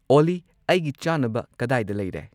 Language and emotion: Manipuri, neutral